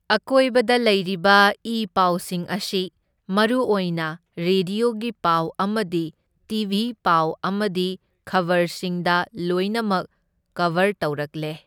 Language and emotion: Manipuri, neutral